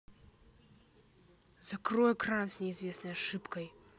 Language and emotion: Russian, angry